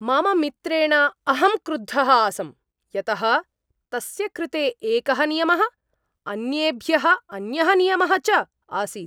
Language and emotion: Sanskrit, angry